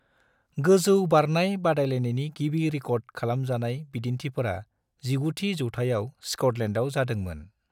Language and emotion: Bodo, neutral